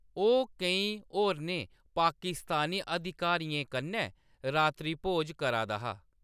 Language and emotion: Dogri, neutral